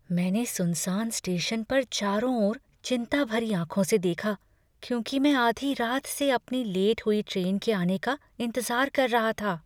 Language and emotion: Hindi, fearful